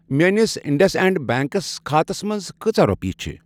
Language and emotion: Kashmiri, neutral